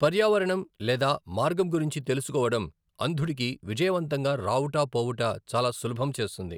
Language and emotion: Telugu, neutral